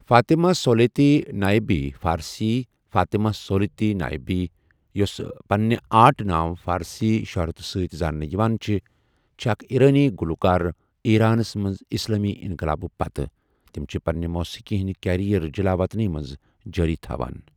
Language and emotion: Kashmiri, neutral